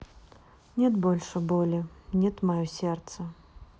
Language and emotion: Russian, sad